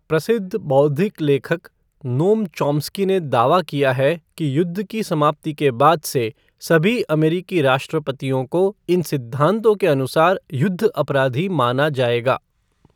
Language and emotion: Hindi, neutral